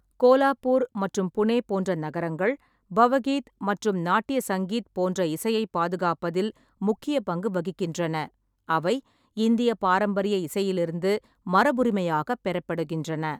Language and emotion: Tamil, neutral